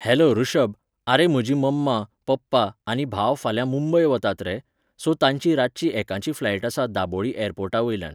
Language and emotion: Goan Konkani, neutral